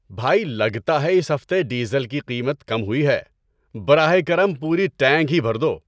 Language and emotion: Urdu, happy